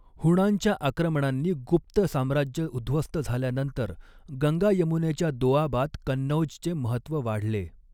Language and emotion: Marathi, neutral